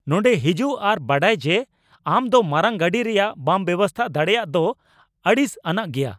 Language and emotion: Santali, angry